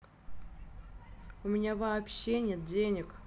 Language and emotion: Russian, angry